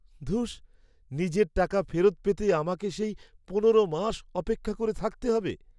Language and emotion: Bengali, sad